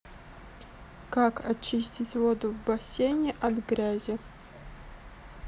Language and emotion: Russian, neutral